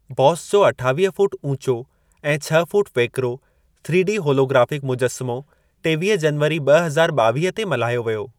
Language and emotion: Sindhi, neutral